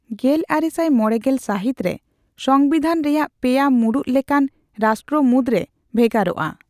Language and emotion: Santali, neutral